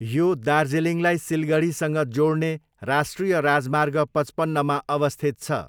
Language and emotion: Nepali, neutral